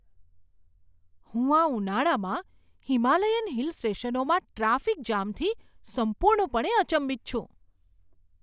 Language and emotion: Gujarati, surprised